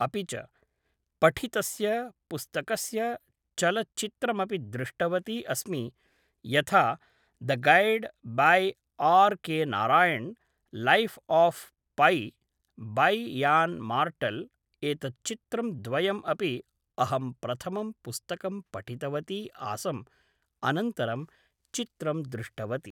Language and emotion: Sanskrit, neutral